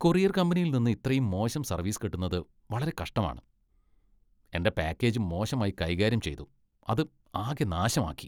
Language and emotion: Malayalam, disgusted